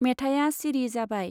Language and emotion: Bodo, neutral